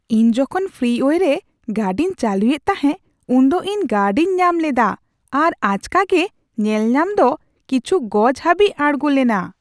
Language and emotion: Santali, surprised